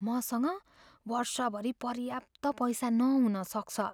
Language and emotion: Nepali, fearful